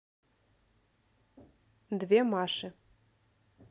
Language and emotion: Russian, neutral